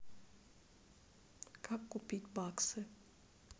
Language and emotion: Russian, neutral